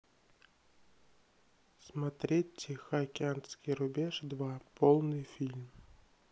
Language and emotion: Russian, neutral